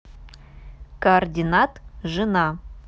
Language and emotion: Russian, neutral